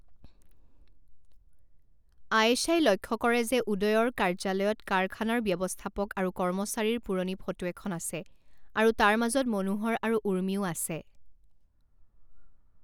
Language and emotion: Assamese, neutral